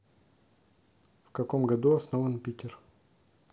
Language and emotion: Russian, neutral